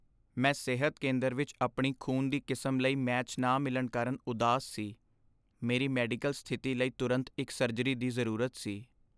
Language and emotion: Punjabi, sad